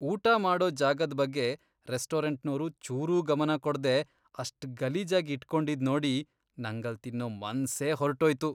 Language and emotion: Kannada, disgusted